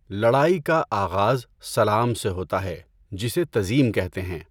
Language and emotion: Urdu, neutral